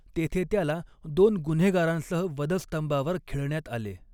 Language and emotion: Marathi, neutral